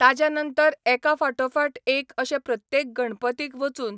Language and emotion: Goan Konkani, neutral